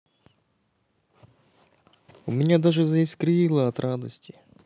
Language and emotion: Russian, neutral